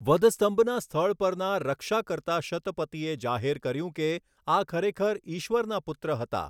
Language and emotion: Gujarati, neutral